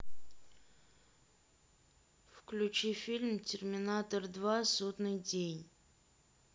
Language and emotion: Russian, neutral